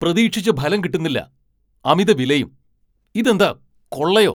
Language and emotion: Malayalam, angry